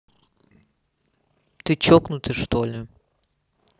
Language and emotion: Russian, angry